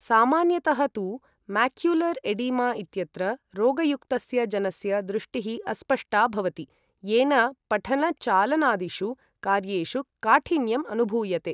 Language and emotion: Sanskrit, neutral